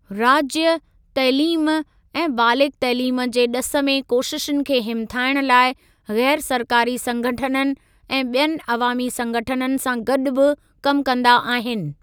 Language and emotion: Sindhi, neutral